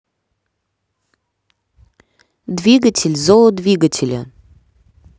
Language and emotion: Russian, neutral